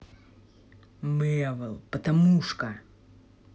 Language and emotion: Russian, angry